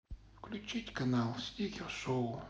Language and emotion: Russian, sad